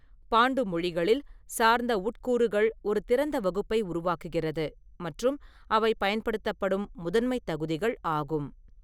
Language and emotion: Tamil, neutral